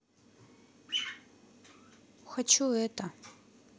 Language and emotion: Russian, neutral